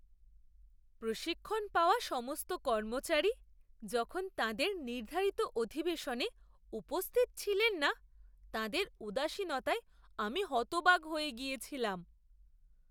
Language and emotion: Bengali, surprised